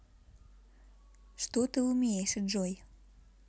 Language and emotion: Russian, neutral